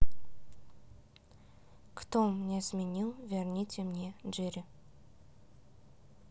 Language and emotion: Russian, neutral